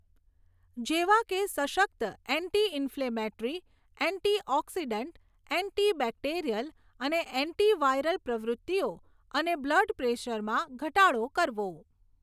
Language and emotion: Gujarati, neutral